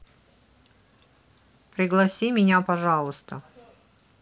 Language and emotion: Russian, neutral